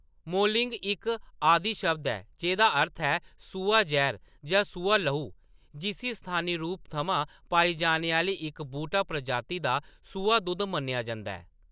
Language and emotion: Dogri, neutral